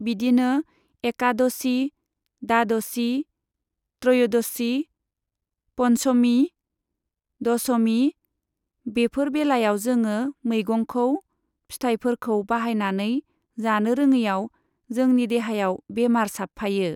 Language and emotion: Bodo, neutral